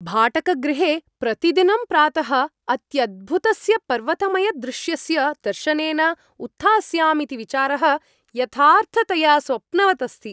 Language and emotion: Sanskrit, happy